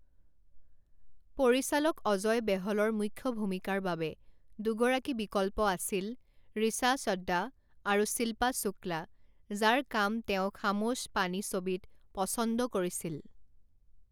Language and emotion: Assamese, neutral